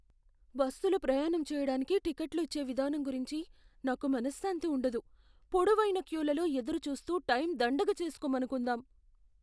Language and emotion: Telugu, fearful